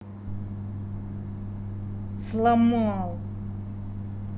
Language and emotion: Russian, angry